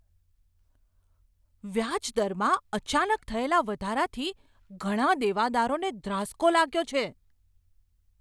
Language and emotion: Gujarati, surprised